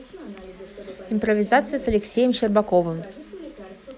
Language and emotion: Russian, neutral